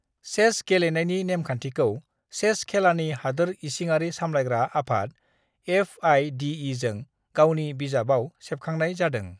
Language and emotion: Bodo, neutral